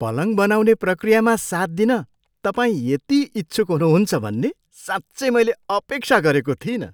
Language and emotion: Nepali, surprised